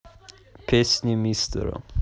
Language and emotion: Russian, neutral